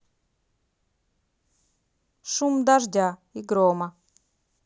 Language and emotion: Russian, neutral